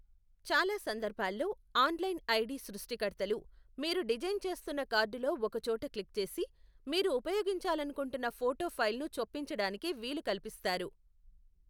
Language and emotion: Telugu, neutral